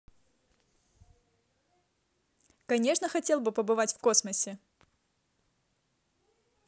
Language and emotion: Russian, positive